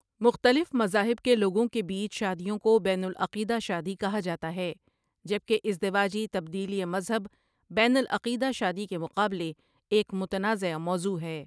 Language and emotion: Urdu, neutral